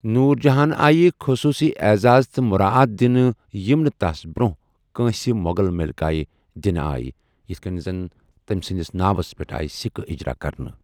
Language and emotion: Kashmiri, neutral